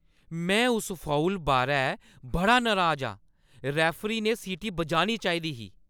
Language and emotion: Dogri, angry